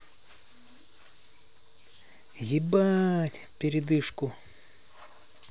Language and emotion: Russian, neutral